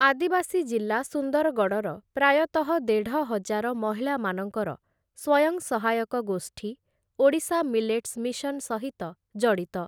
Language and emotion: Odia, neutral